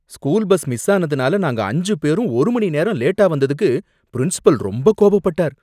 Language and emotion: Tamil, angry